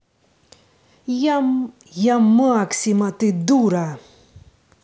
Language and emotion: Russian, angry